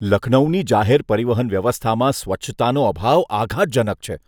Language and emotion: Gujarati, disgusted